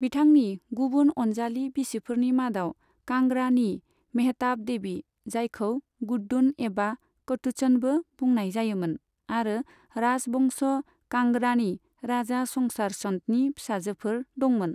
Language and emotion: Bodo, neutral